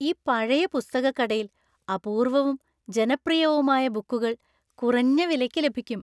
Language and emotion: Malayalam, happy